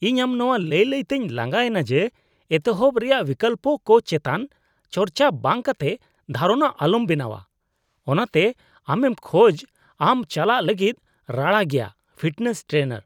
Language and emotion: Santali, disgusted